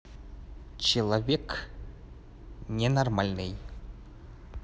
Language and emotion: Russian, angry